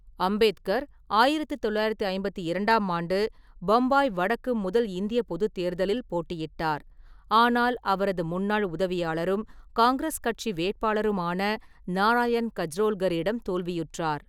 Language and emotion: Tamil, neutral